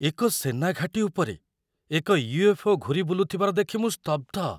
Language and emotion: Odia, surprised